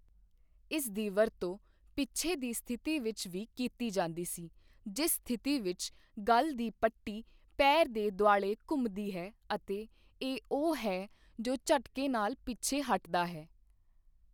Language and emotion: Punjabi, neutral